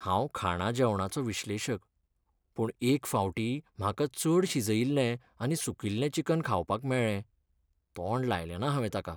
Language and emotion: Goan Konkani, sad